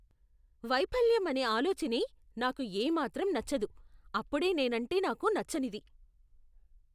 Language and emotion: Telugu, disgusted